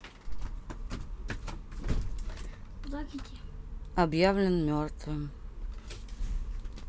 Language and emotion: Russian, neutral